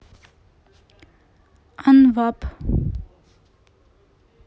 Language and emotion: Russian, neutral